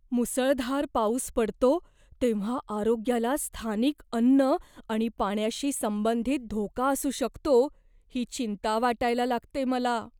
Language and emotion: Marathi, fearful